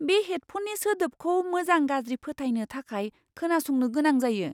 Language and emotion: Bodo, surprised